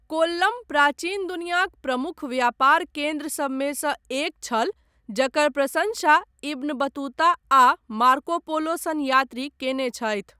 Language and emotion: Maithili, neutral